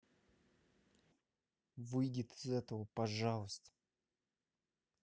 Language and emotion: Russian, angry